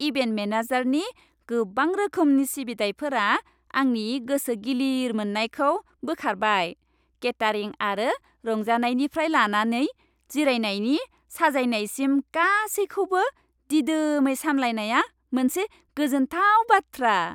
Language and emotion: Bodo, happy